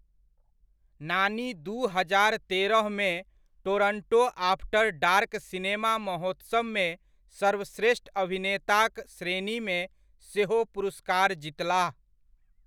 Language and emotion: Maithili, neutral